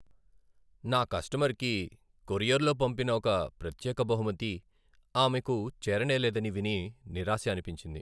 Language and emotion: Telugu, sad